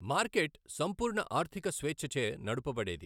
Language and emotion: Telugu, neutral